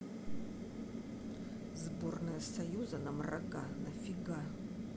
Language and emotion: Russian, angry